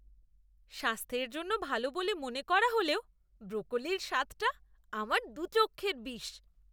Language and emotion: Bengali, disgusted